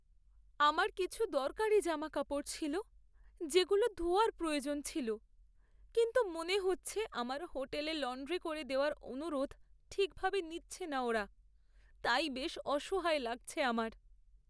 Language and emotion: Bengali, sad